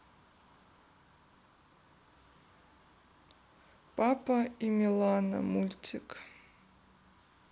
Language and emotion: Russian, sad